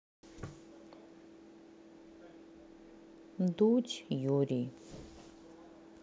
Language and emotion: Russian, neutral